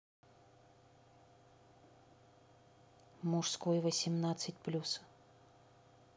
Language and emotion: Russian, neutral